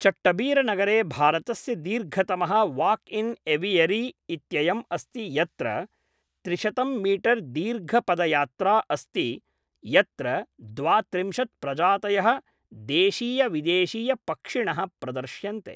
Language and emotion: Sanskrit, neutral